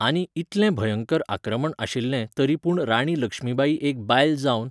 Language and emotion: Goan Konkani, neutral